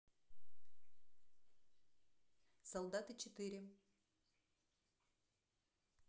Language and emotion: Russian, neutral